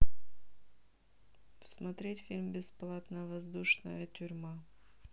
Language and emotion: Russian, neutral